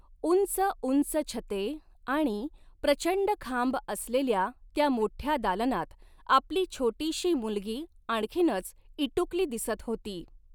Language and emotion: Marathi, neutral